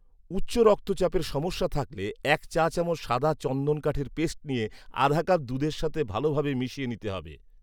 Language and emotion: Bengali, neutral